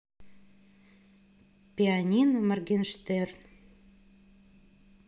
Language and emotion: Russian, neutral